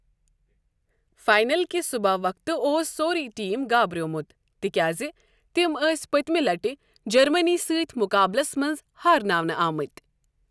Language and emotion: Kashmiri, neutral